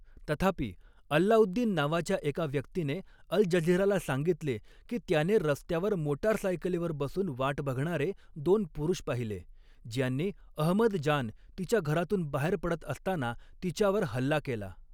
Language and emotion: Marathi, neutral